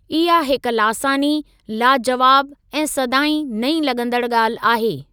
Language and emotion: Sindhi, neutral